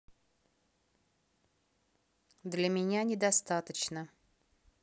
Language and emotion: Russian, neutral